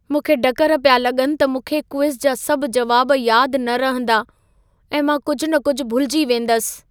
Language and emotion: Sindhi, fearful